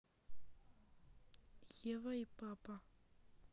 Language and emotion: Russian, neutral